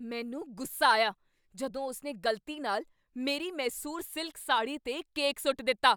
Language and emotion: Punjabi, angry